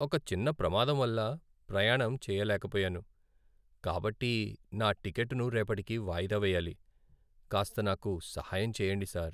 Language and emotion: Telugu, sad